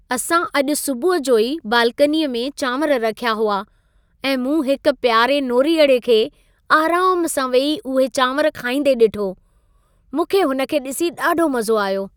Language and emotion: Sindhi, happy